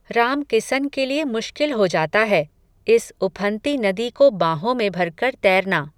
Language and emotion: Hindi, neutral